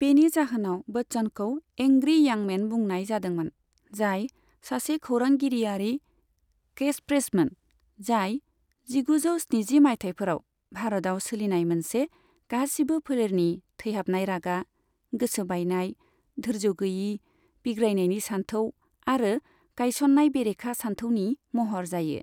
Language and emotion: Bodo, neutral